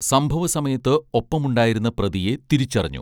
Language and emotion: Malayalam, neutral